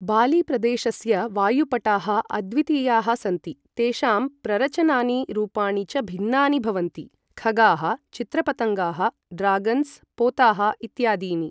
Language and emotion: Sanskrit, neutral